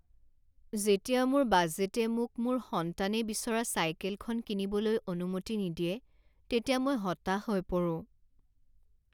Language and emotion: Assamese, sad